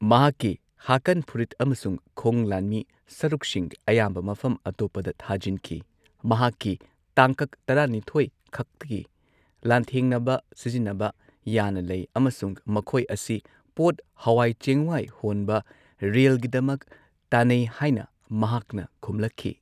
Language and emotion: Manipuri, neutral